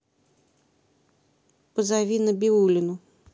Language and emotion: Russian, neutral